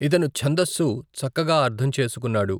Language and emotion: Telugu, neutral